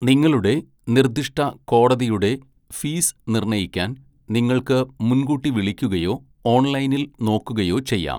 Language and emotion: Malayalam, neutral